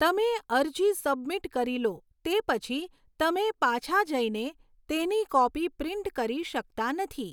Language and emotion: Gujarati, neutral